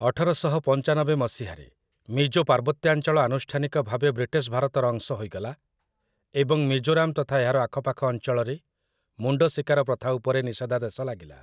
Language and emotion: Odia, neutral